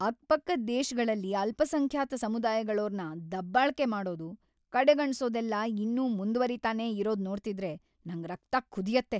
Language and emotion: Kannada, angry